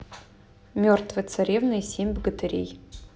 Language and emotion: Russian, neutral